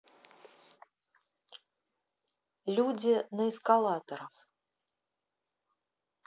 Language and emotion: Russian, neutral